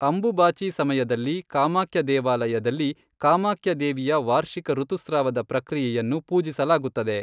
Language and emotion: Kannada, neutral